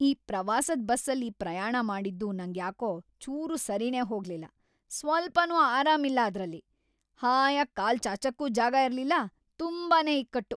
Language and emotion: Kannada, angry